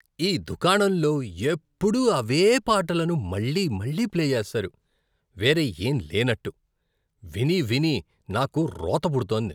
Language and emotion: Telugu, disgusted